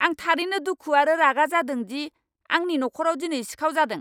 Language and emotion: Bodo, angry